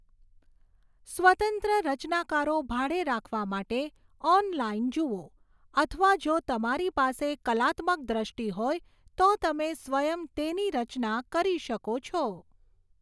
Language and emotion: Gujarati, neutral